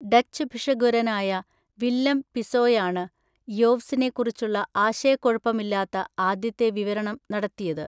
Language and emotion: Malayalam, neutral